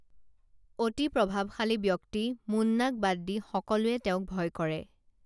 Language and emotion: Assamese, neutral